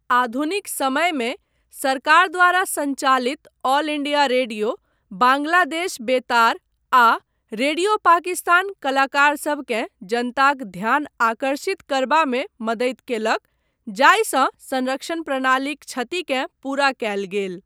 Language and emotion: Maithili, neutral